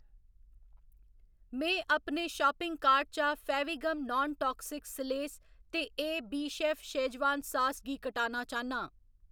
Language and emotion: Dogri, neutral